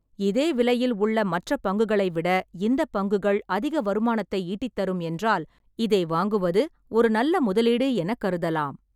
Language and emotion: Tamil, neutral